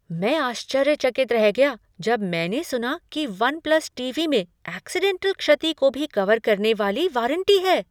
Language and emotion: Hindi, surprised